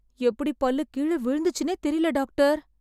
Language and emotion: Tamil, surprised